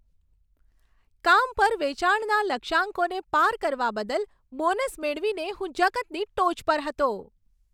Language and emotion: Gujarati, happy